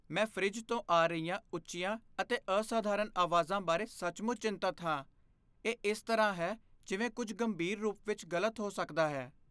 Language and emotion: Punjabi, fearful